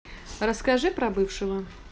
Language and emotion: Russian, neutral